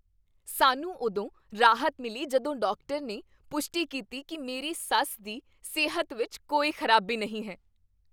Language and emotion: Punjabi, happy